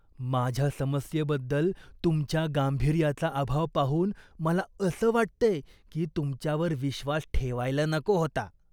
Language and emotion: Marathi, disgusted